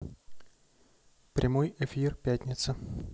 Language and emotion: Russian, neutral